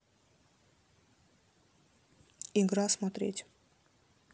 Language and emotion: Russian, neutral